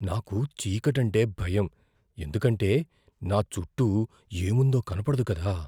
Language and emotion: Telugu, fearful